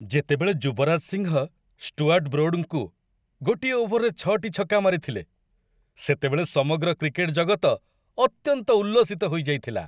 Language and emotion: Odia, happy